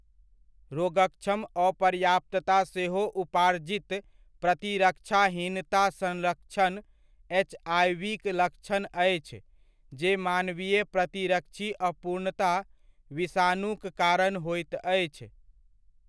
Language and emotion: Maithili, neutral